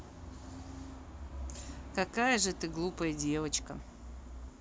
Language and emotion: Russian, neutral